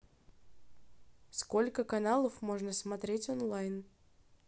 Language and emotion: Russian, neutral